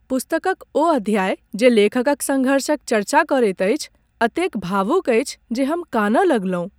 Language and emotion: Maithili, sad